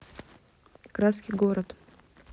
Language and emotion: Russian, neutral